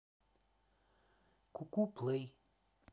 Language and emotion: Russian, neutral